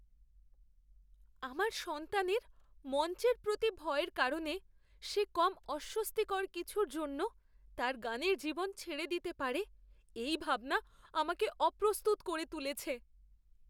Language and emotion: Bengali, fearful